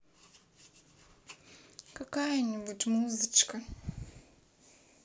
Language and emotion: Russian, neutral